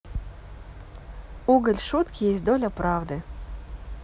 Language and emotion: Russian, positive